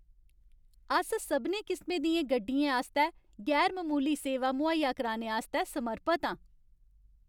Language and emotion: Dogri, happy